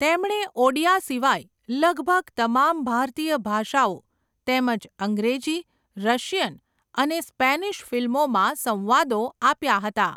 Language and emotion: Gujarati, neutral